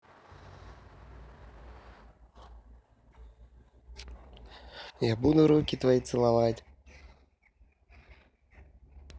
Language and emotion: Russian, neutral